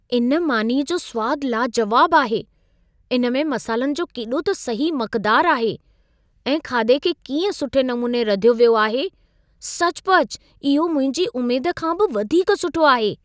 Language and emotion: Sindhi, surprised